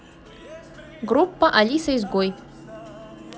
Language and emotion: Russian, positive